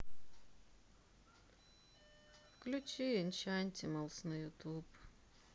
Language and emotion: Russian, sad